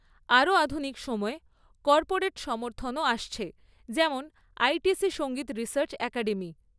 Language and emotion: Bengali, neutral